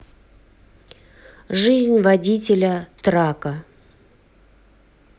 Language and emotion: Russian, neutral